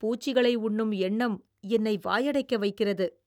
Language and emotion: Tamil, disgusted